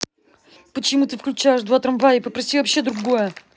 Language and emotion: Russian, angry